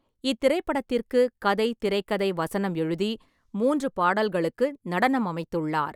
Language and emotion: Tamil, neutral